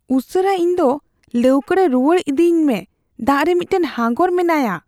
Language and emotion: Santali, fearful